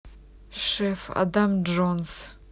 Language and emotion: Russian, neutral